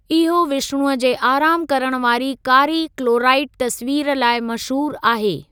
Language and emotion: Sindhi, neutral